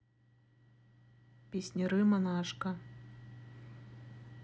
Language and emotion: Russian, neutral